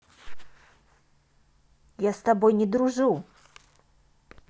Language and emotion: Russian, angry